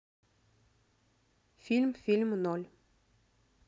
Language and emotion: Russian, neutral